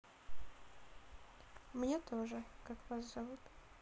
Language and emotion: Russian, neutral